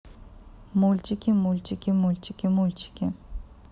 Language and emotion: Russian, neutral